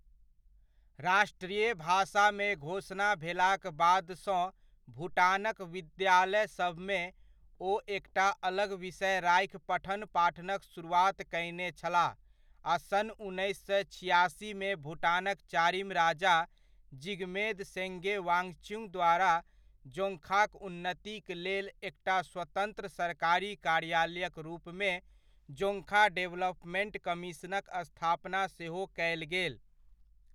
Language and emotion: Maithili, neutral